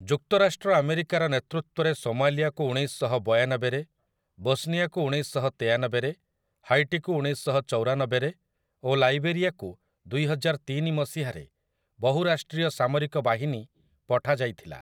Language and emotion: Odia, neutral